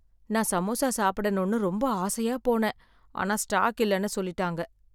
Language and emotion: Tamil, sad